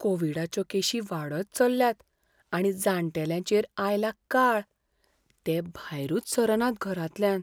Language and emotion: Goan Konkani, fearful